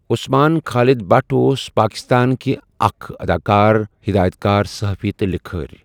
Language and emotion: Kashmiri, neutral